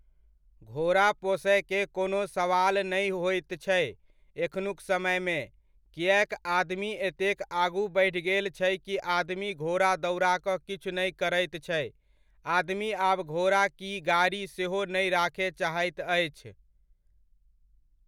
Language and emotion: Maithili, neutral